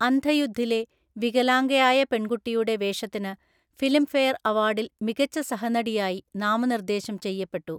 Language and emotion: Malayalam, neutral